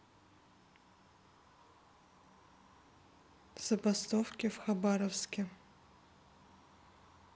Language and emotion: Russian, neutral